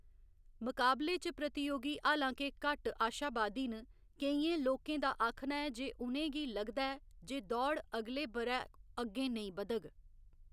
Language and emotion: Dogri, neutral